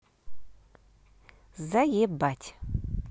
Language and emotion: Russian, neutral